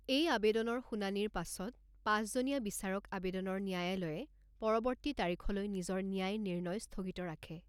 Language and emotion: Assamese, neutral